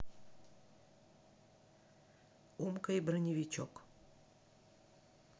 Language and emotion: Russian, neutral